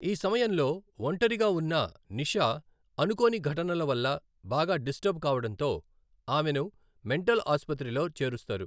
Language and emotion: Telugu, neutral